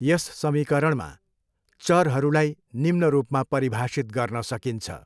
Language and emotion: Nepali, neutral